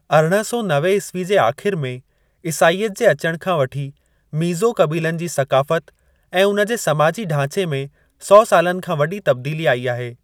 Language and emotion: Sindhi, neutral